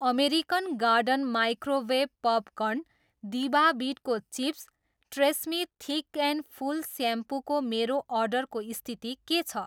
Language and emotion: Nepali, neutral